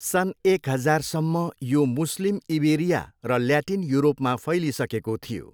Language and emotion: Nepali, neutral